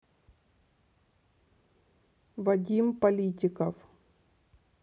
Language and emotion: Russian, neutral